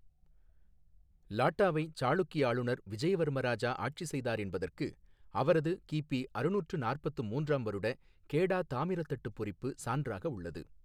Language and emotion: Tamil, neutral